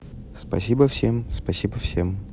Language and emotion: Russian, neutral